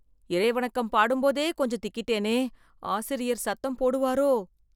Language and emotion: Tamil, fearful